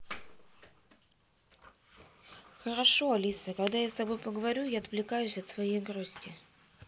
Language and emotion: Russian, neutral